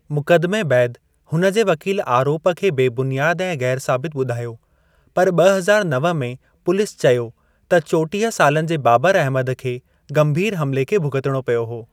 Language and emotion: Sindhi, neutral